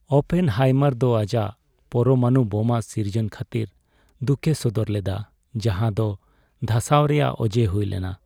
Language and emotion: Santali, sad